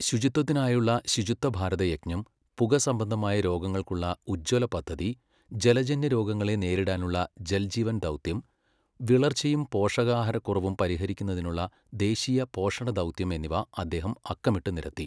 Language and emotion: Malayalam, neutral